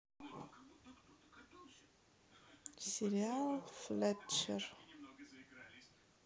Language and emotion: Russian, neutral